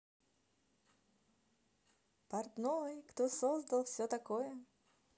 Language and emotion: Russian, positive